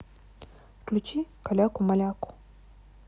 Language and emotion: Russian, neutral